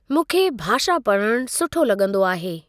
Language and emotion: Sindhi, neutral